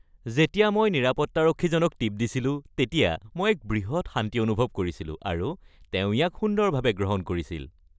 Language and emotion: Assamese, happy